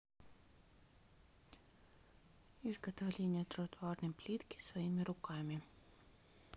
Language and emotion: Russian, neutral